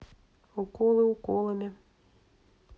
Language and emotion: Russian, neutral